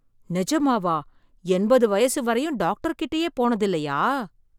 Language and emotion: Tamil, surprised